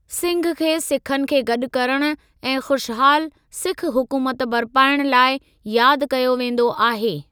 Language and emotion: Sindhi, neutral